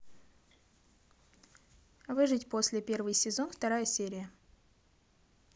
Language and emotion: Russian, neutral